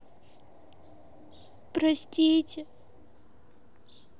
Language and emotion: Russian, sad